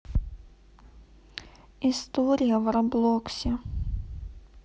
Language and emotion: Russian, neutral